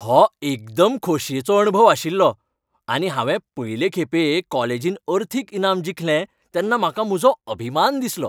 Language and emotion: Goan Konkani, happy